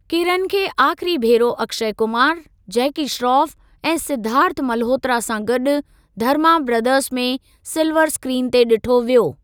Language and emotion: Sindhi, neutral